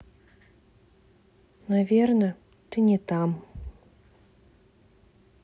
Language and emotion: Russian, sad